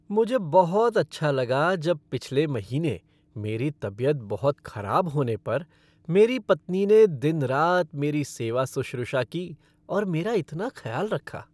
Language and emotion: Hindi, happy